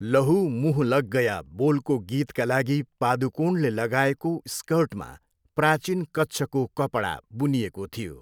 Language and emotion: Nepali, neutral